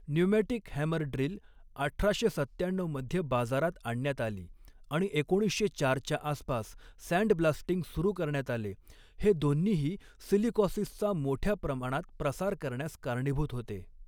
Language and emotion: Marathi, neutral